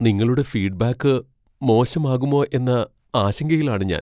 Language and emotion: Malayalam, fearful